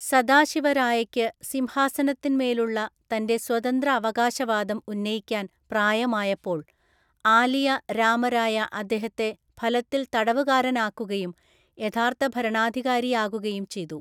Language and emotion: Malayalam, neutral